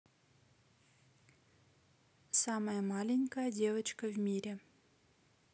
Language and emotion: Russian, neutral